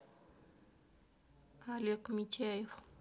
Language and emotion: Russian, neutral